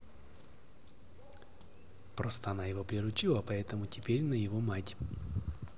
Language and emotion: Russian, neutral